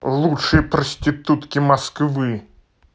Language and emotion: Russian, angry